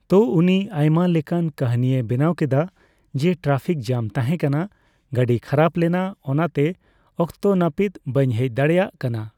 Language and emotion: Santali, neutral